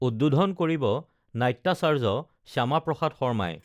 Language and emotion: Assamese, neutral